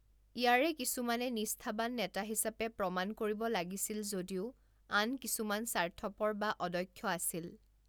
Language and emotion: Assamese, neutral